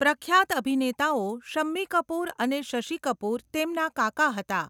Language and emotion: Gujarati, neutral